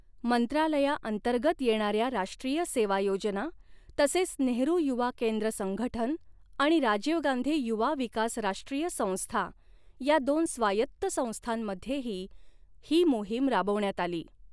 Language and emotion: Marathi, neutral